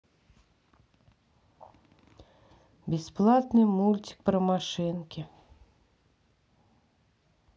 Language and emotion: Russian, sad